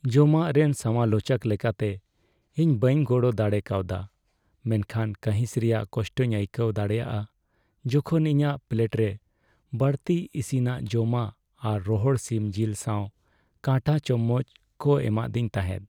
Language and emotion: Santali, sad